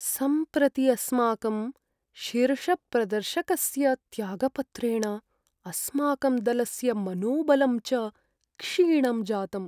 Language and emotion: Sanskrit, sad